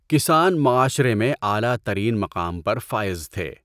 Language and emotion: Urdu, neutral